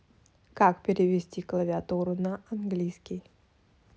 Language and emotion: Russian, neutral